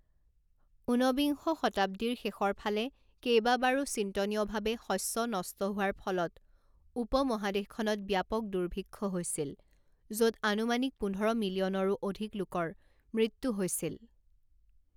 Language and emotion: Assamese, neutral